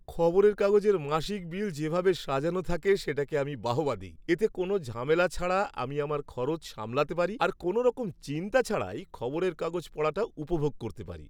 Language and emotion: Bengali, happy